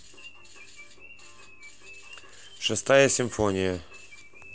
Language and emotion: Russian, neutral